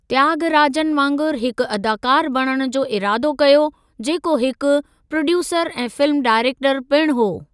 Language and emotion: Sindhi, neutral